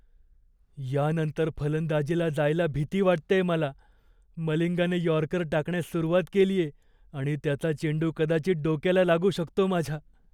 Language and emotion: Marathi, fearful